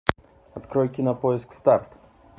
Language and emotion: Russian, neutral